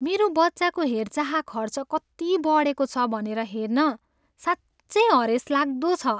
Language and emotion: Nepali, sad